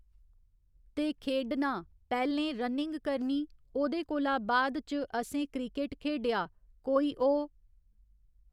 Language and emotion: Dogri, neutral